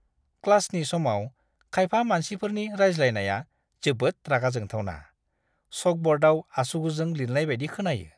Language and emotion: Bodo, disgusted